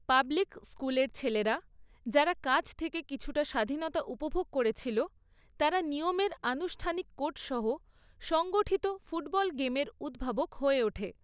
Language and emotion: Bengali, neutral